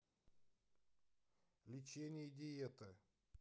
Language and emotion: Russian, neutral